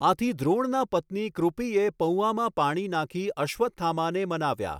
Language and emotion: Gujarati, neutral